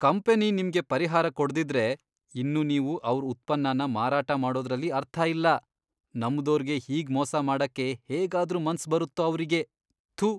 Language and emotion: Kannada, disgusted